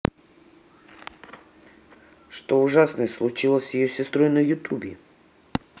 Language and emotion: Russian, neutral